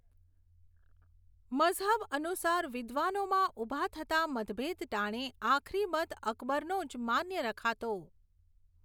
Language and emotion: Gujarati, neutral